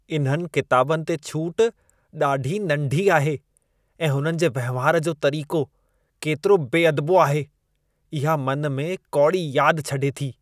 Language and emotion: Sindhi, disgusted